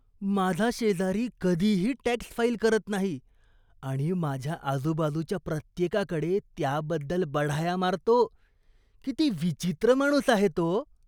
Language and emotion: Marathi, disgusted